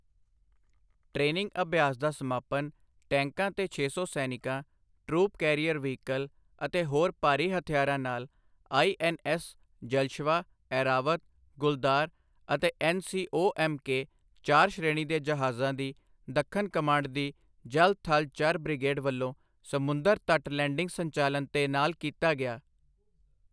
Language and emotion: Punjabi, neutral